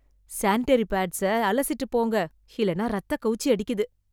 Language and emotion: Tamil, disgusted